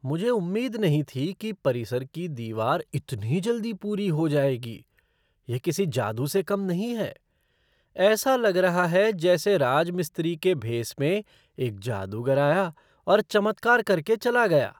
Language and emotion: Hindi, surprised